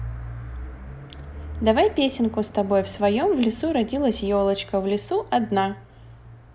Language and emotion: Russian, positive